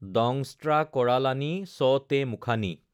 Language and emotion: Assamese, neutral